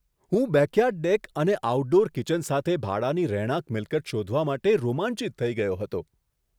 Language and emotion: Gujarati, surprised